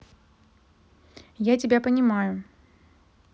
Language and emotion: Russian, neutral